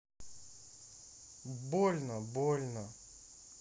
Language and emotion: Russian, sad